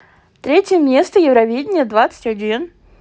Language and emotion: Russian, positive